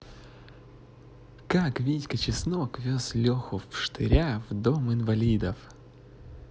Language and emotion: Russian, positive